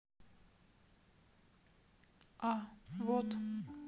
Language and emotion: Russian, neutral